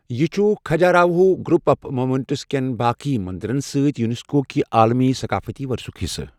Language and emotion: Kashmiri, neutral